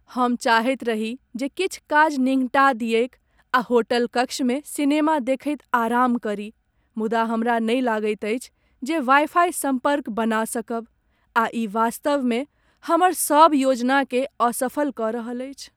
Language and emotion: Maithili, sad